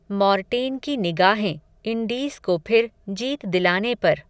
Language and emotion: Hindi, neutral